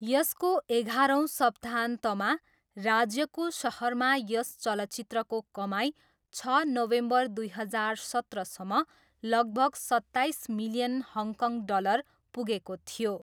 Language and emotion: Nepali, neutral